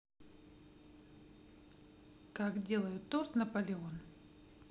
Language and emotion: Russian, neutral